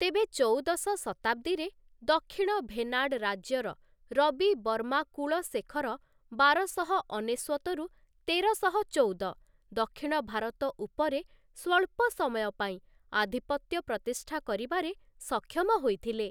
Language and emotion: Odia, neutral